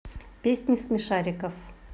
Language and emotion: Russian, neutral